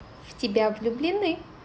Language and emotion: Russian, positive